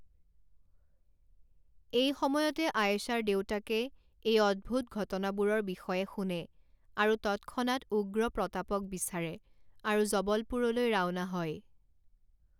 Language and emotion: Assamese, neutral